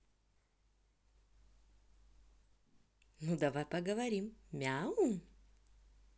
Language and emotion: Russian, positive